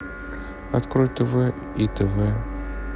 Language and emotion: Russian, neutral